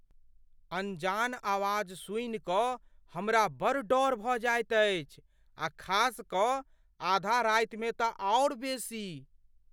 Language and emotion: Maithili, fearful